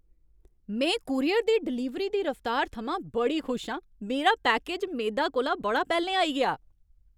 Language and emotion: Dogri, happy